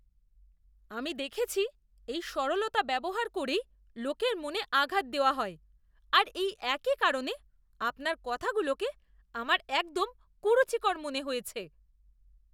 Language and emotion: Bengali, disgusted